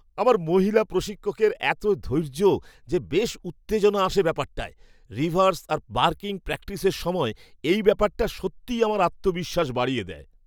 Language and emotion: Bengali, happy